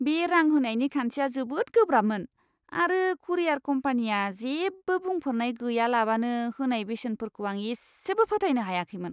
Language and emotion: Bodo, disgusted